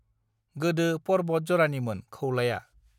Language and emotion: Bodo, neutral